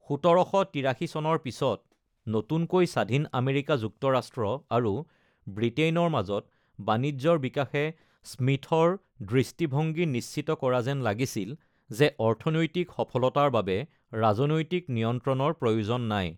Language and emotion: Assamese, neutral